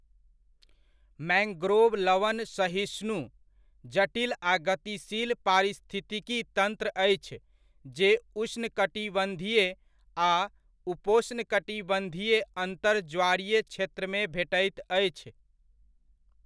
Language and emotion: Maithili, neutral